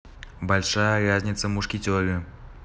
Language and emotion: Russian, neutral